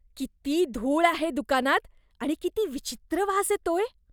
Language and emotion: Marathi, disgusted